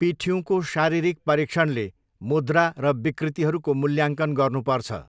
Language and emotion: Nepali, neutral